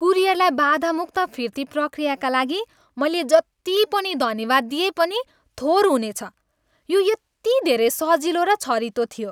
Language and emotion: Nepali, happy